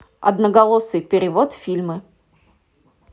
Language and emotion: Russian, neutral